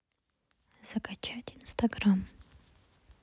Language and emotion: Russian, neutral